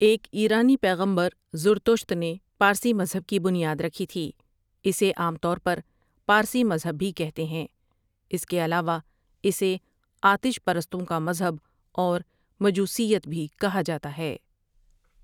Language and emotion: Urdu, neutral